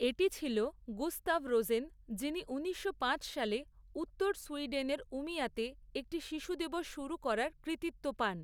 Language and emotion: Bengali, neutral